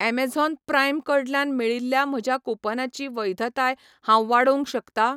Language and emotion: Goan Konkani, neutral